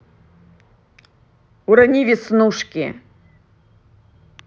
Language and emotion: Russian, angry